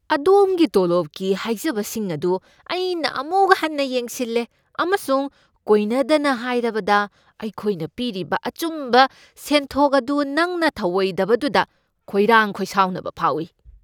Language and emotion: Manipuri, angry